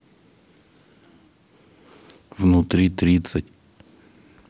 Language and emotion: Russian, neutral